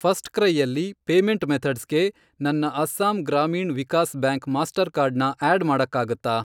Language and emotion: Kannada, neutral